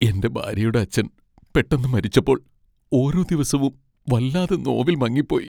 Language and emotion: Malayalam, sad